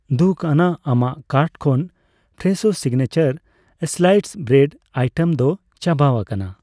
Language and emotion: Santali, neutral